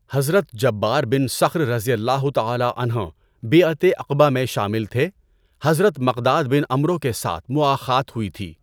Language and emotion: Urdu, neutral